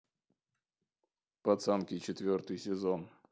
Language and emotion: Russian, neutral